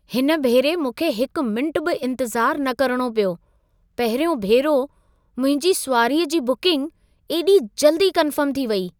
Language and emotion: Sindhi, surprised